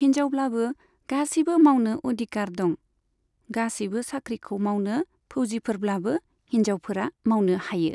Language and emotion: Bodo, neutral